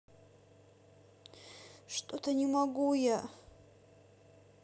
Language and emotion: Russian, sad